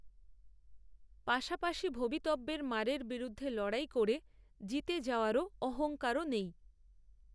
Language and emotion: Bengali, neutral